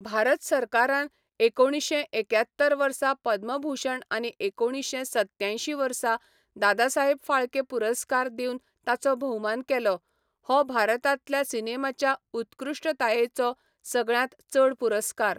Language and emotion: Goan Konkani, neutral